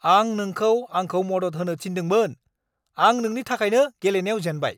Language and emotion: Bodo, angry